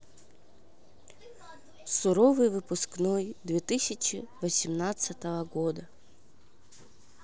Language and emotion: Russian, sad